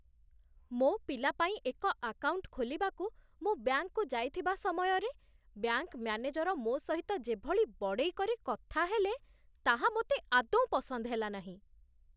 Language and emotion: Odia, disgusted